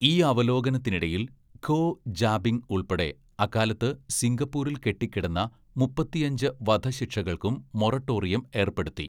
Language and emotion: Malayalam, neutral